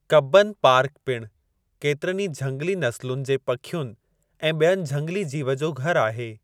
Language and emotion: Sindhi, neutral